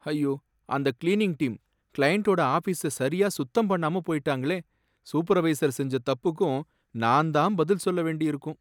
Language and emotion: Tamil, sad